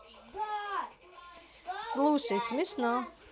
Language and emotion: Russian, positive